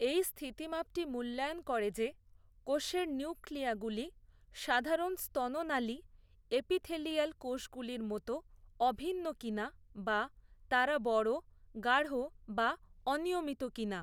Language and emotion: Bengali, neutral